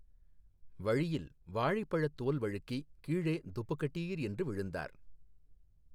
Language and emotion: Tamil, neutral